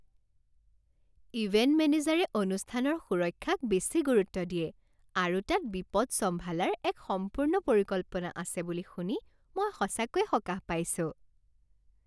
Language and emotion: Assamese, happy